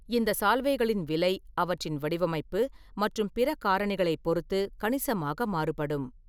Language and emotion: Tamil, neutral